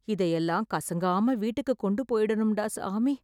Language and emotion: Tamil, sad